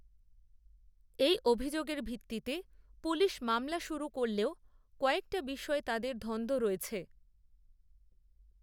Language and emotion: Bengali, neutral